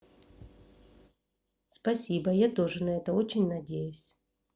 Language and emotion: Russian, neutral